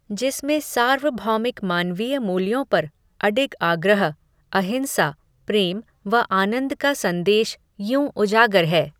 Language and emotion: Hindi, neutral